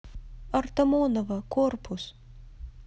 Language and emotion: Russian, neutral